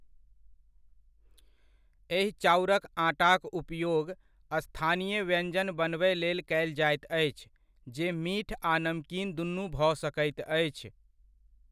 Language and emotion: Maithili, neutral